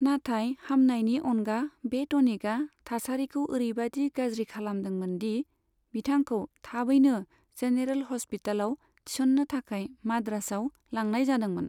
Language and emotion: Bodo, neutral